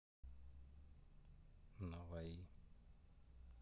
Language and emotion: Russian, neutral